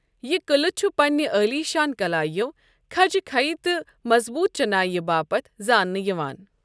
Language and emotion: Kashmiri, neutral